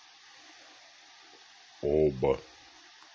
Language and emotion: Russian, neutral